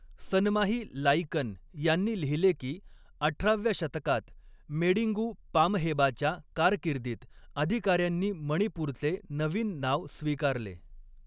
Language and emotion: Marathi, neutral